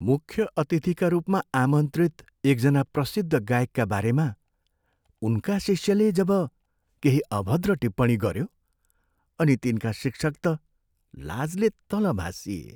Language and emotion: Nepali, sad